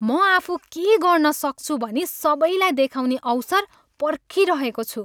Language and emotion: Nepali, happy